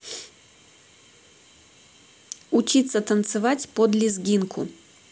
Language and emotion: Russian, neutral